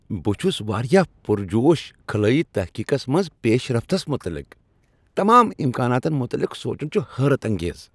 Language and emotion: Kashmiri, happy